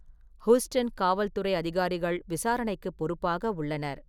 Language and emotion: Tamil, neutral